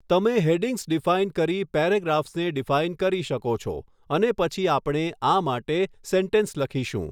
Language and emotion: Gujarati, neutral